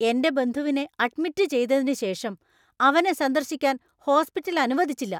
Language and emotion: Malayalam, angry